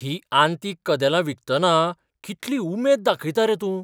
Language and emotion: Goan Konkani, surprised